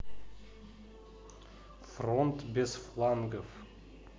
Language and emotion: Russian, neutral